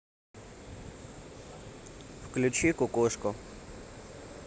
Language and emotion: Russian, neutral